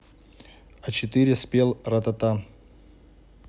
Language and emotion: Russian, neutral